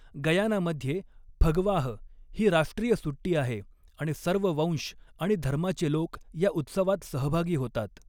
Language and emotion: Marathi, neutral